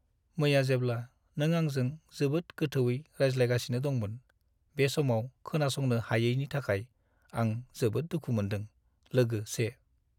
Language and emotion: Bodo, sad